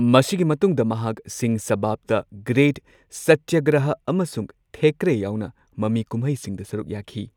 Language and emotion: Manipuri, neutral